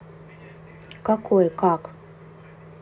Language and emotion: Russian, neutral